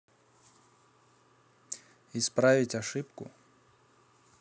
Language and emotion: Russian, neutral